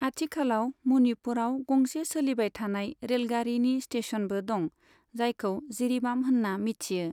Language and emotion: Bodo, neutral